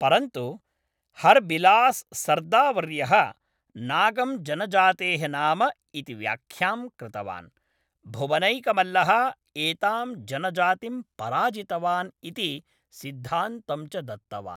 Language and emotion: Sanskrit, neutral